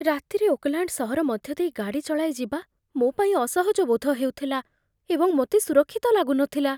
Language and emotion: Odia, fearful